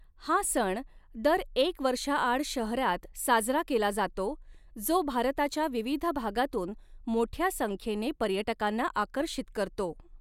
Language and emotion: Marathi, neutral